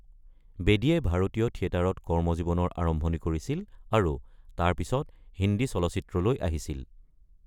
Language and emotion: Assamese, neutral